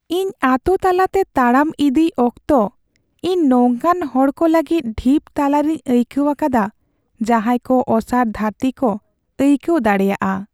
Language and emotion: Santali, sad